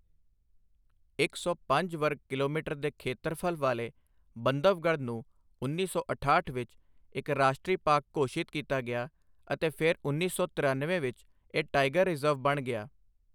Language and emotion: Punjabi, neutral